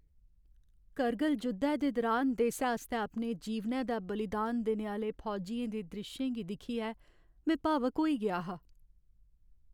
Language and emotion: Dogri, sad